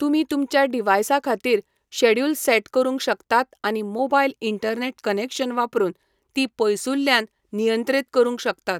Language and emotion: Goan Konkani, neutral